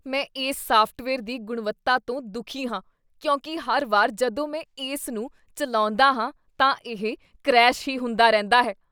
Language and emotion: Punjabi, disgusted